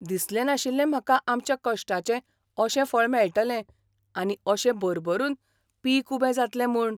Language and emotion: Goan Konkani, surprised